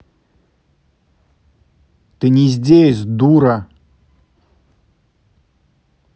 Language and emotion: Russian, angry